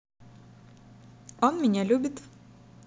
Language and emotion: Russian, positive